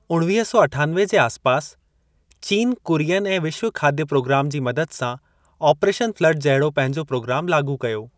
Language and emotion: Sindhi, neutral